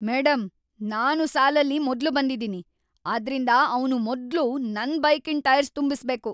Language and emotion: Kannada, angry